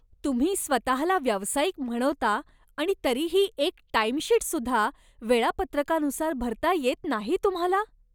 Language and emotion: Marathi, disgusted